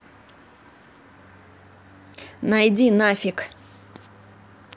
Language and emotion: Russian, angry